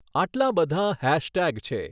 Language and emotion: Gujarati, neutral